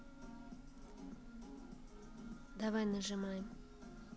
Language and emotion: Russian, neutral